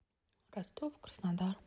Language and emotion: Russian, neutral